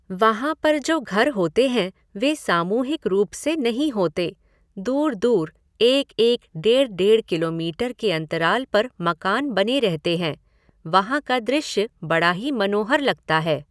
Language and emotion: Hindi, neutral